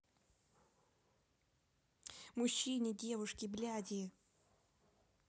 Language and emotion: Russian, angry